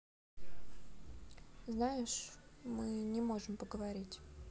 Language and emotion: Russian, sad